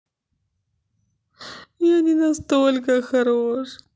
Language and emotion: Russian, sad